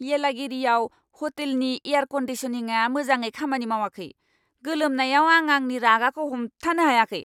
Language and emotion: Bodo, angry